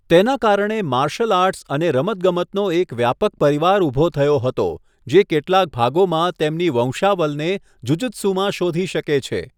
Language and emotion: Gujarati, neutral